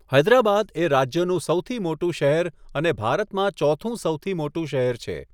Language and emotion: Gujarati, neutral